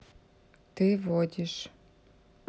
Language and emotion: Russian, neutral